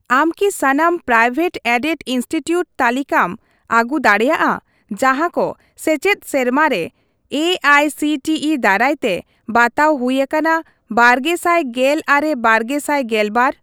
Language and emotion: Santali, neutral